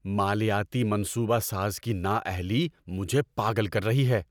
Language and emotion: Urdu, angry